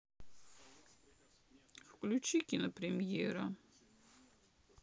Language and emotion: Russian, sad